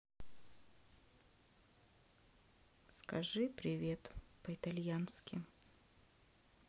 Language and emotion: Russian, sad